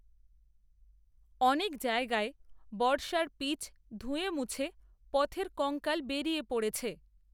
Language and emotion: Bengali, neutral